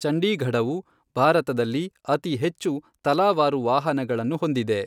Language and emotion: Kannada, neutral